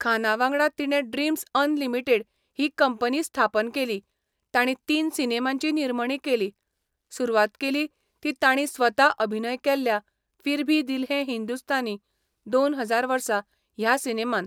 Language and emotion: Goan Konkani, neutral